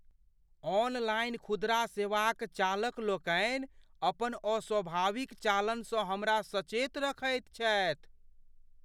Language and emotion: Maithili, fearful